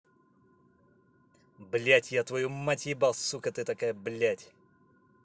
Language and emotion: Russian, angry